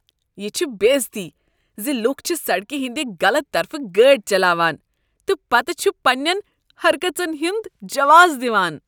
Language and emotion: Kashmiri, disgusted